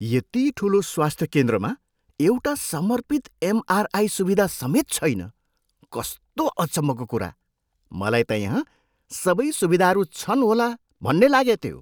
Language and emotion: Nepali, surprised